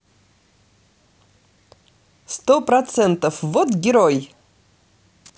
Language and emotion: Russian, positive